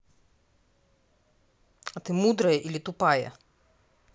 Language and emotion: Russian, angry